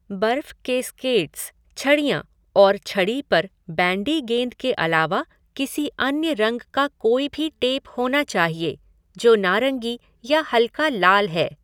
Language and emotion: Hindi, neutral